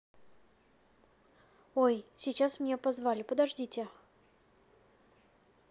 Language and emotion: Russian, neutral